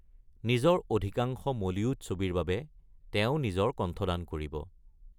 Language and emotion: Assamese, neutral